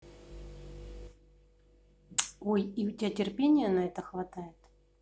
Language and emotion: Russian, neutral